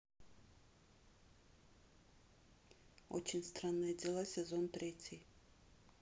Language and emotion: Russian, neutral